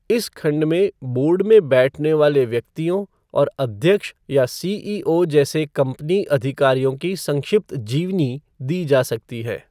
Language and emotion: Hindi, neutral